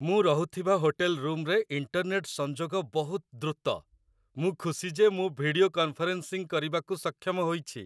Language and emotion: Odia, happy